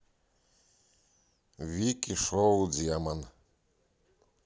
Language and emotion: Russian, neutral